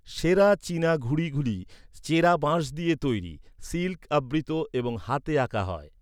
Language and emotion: Bengali, neutral